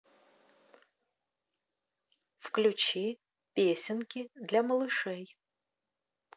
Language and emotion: Russian, neutral